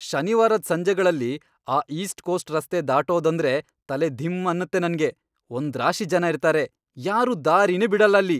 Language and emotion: Kannada, angry